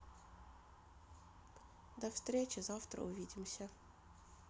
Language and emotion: Russian, neutral